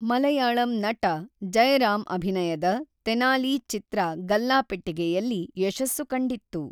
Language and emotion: Kannada, neutral